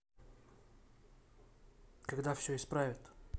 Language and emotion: Russian, neutral